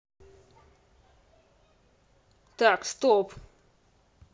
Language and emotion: Russian, angry